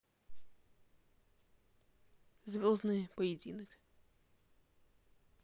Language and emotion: Russian, neutral